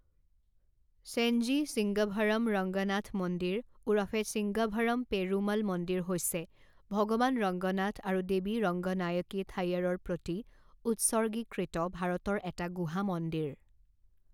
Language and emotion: Assamese, neutral